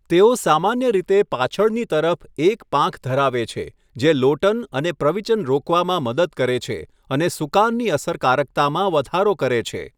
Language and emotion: Gujarati, neutral